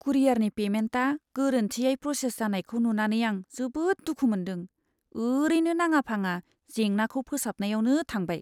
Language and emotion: Bodo, sad